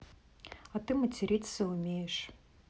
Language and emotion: Russian, neutral